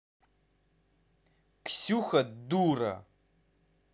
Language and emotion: Russian, angry